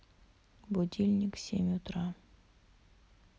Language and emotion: Russian, sad